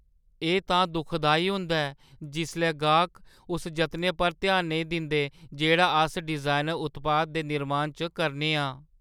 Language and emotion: Dogri, sad